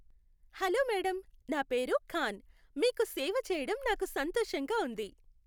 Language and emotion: Telugu, happy